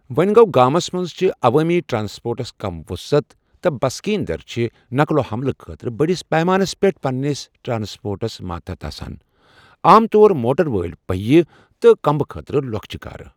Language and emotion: Kashmiri, neutral